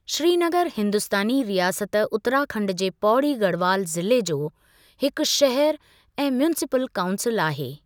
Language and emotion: Sindhi, neutral